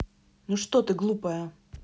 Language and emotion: Russian, angry